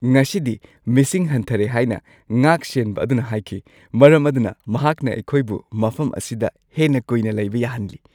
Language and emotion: Manipuri, happy